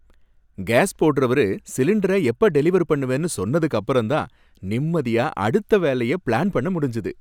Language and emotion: Tamil, happy